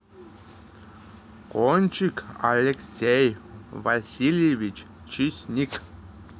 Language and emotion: Russian, neutral